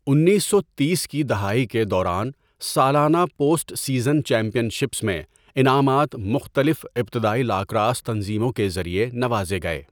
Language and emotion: Urdu, neutral